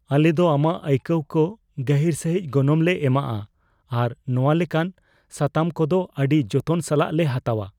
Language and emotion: Santali, fearful